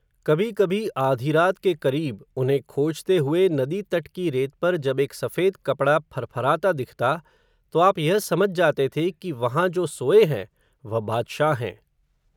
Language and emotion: Hindi, neutral